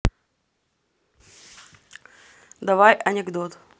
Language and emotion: Russian, neutral